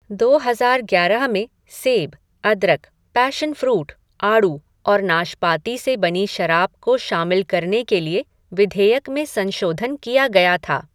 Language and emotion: Hindi, neutral